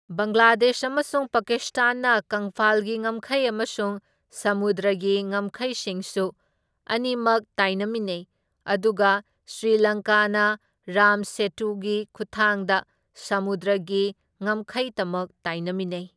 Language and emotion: Manipuri, neutral